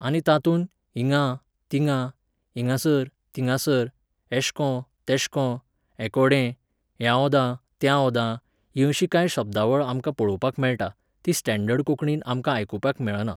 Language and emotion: Goan Konkani, neutral